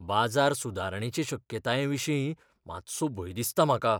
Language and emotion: Goan Konkani, fearful